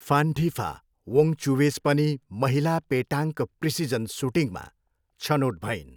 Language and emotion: Nepali, neutral